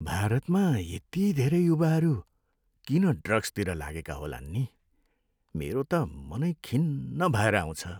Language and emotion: Nepali, sad